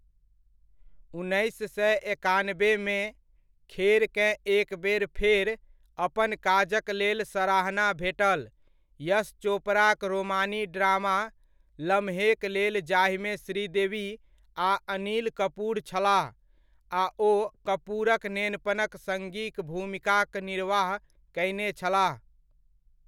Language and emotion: Maithili, neutral